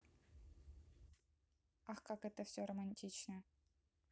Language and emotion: Russian, neutral